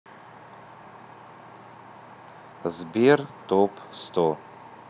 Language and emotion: Russian, neutral